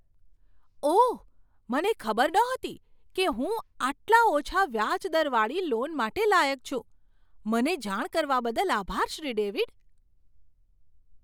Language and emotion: Gujarati, surprised